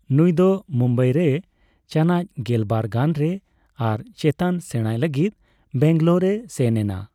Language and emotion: Santali, neutral